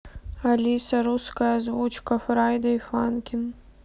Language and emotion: Russian, sad